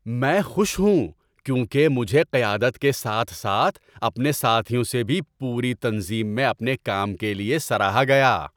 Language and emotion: Urdu, happy